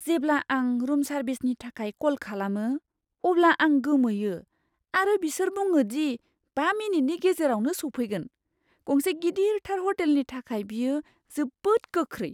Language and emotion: Bodo, surprised